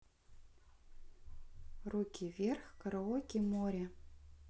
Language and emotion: Russian, neutral